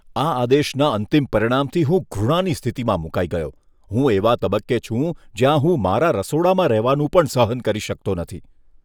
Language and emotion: Gujarati, disgusted